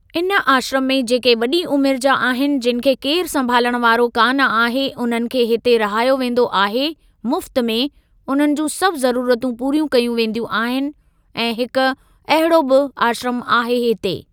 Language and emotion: Sindhi, neutral